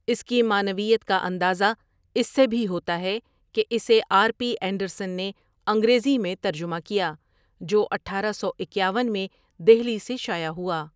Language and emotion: Urdu, neutral